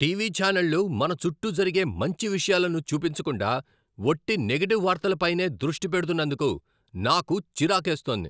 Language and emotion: Telugu, angry